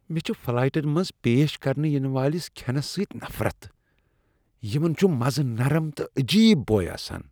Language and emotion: Kashmiri, disgusted